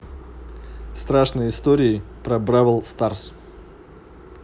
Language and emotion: Russian, neutral